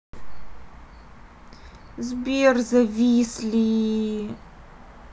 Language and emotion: Russian, sad